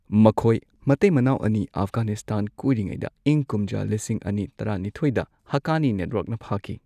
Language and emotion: Manipuri, neutral